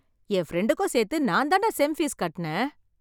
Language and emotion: Tamil, happy